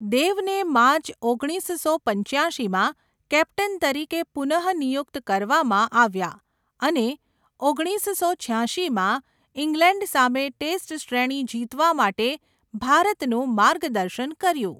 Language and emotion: Gujarati, neutral